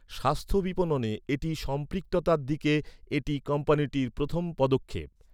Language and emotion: Bengali, neutral